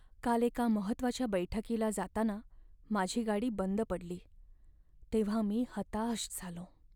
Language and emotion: Marathi, sad